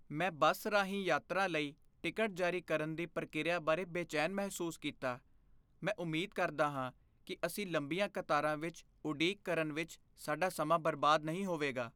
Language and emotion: Punjabi, fearful